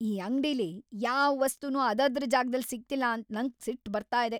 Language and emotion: Kannada, angry